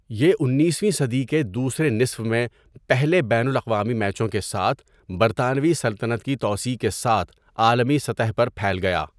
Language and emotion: Urdu, neutral